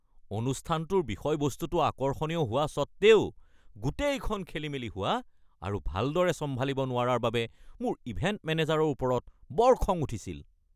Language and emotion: Assamese, angry